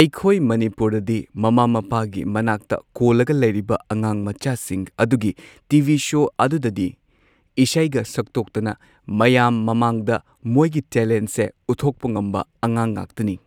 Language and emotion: Manipuri, neutral